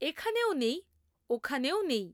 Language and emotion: Bengali, neutral